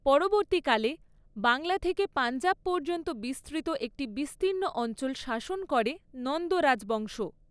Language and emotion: Bengali, neutral